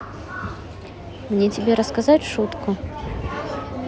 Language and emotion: Russian, neutral